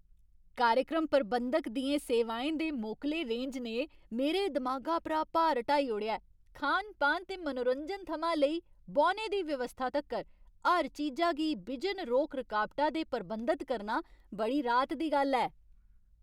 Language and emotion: Dogri, happy